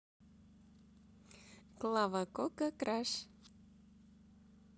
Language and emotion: Russian, positive